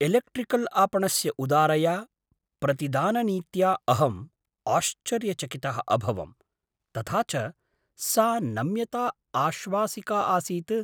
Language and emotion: Sanskrit, surprised